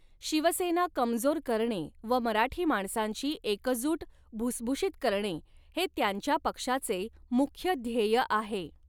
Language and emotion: Marathi, neutral